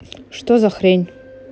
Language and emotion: Russian, angry